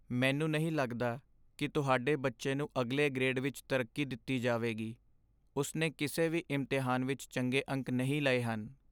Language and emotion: Punjabi, sad